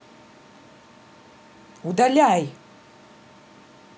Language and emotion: Russian, angry